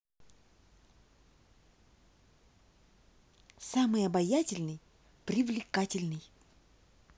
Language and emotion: Russian, positive